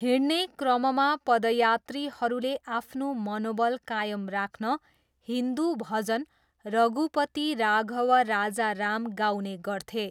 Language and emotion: Nepali, neutral